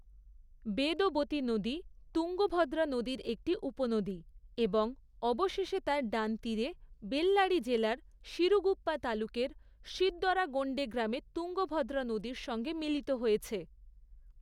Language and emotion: Bengali, neutral